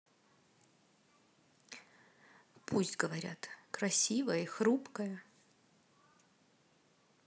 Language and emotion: Russian, neutral